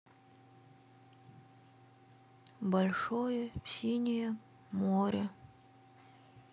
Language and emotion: Russian, neutral